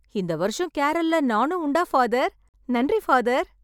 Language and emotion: Tamil, happy